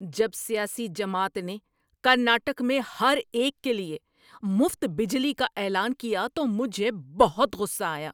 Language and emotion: Urdu, angry